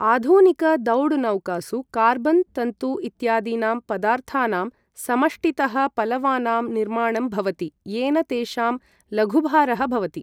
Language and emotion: Sanskrit, neutral